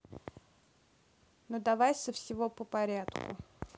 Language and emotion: Russian, neutral